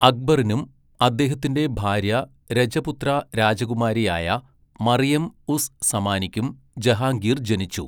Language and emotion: Malayalam, neutral